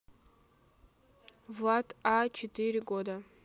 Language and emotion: Russian, neutral